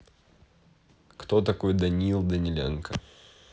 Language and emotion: Russian, neutral